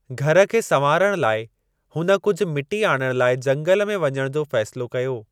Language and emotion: Sindhi, neutral